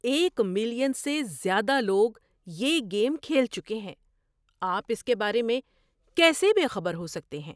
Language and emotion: Urdu, surprised